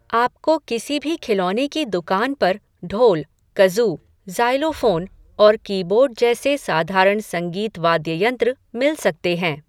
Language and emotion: Hindi, neutral